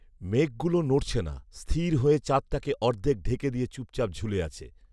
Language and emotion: Bengali, neutral